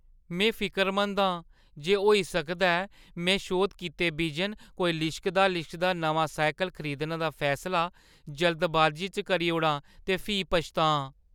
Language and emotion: Dogri, fearful